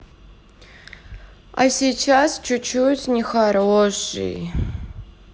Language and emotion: Russian, sad